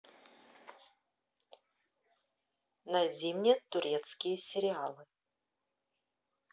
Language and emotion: Russian, neutral